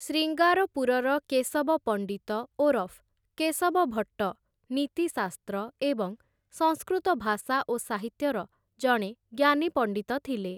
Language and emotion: Odia, neutral